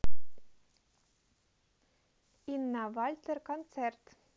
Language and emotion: Russian, neutral